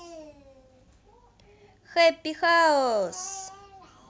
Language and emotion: Russian, positive